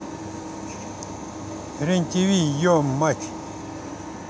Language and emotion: Russian, neutral